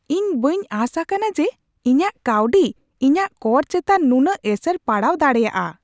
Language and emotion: Santali, surprised